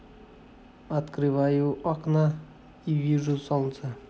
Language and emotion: Russian, neutral